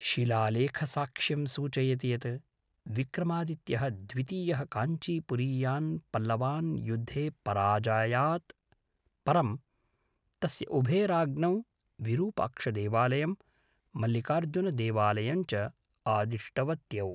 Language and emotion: Sanskrit, neutral